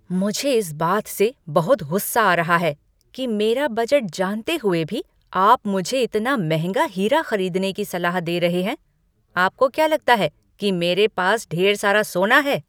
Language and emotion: Hindi, angry